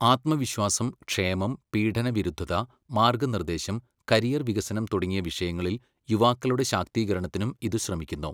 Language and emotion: Malayalam, neutral